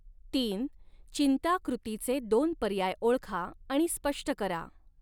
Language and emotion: Marathi, neutral